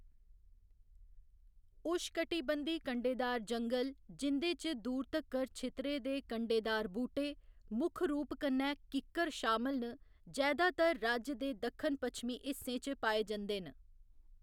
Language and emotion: Dogri, neutral